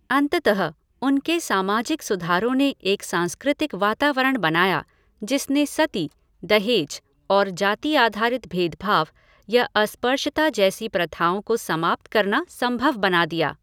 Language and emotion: Hindi, neutral